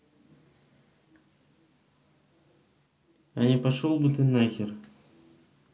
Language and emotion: Russian, neutral